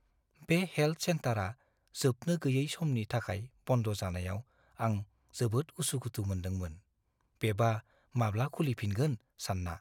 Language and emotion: Bodo, fearful